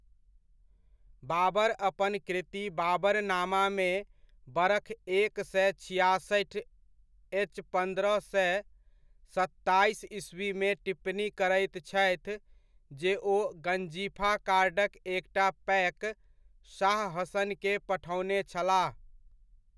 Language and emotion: Maithili, neutral